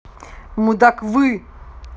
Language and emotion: Russian, angry